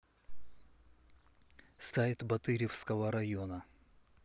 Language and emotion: Russian, neutral